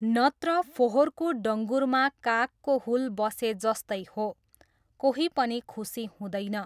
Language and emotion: Nepali, neutral